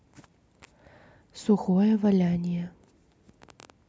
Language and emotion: Russian, neutral